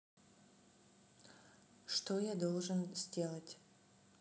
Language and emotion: Russian, neutral